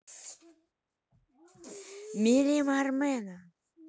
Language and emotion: Russian, neutral